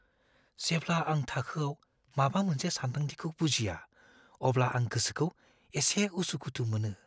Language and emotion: Bodo, fearful